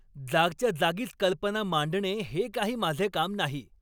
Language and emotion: Marathi, angry